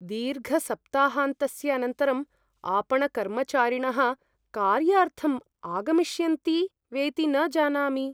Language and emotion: Sanskrit, fearful